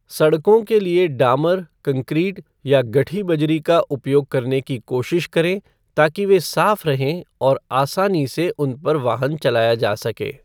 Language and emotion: Hindi, neutral